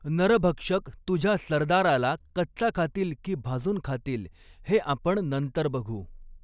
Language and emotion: Marathi, neutral